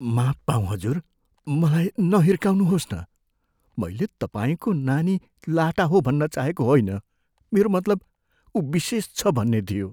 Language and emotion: Nepali, fearful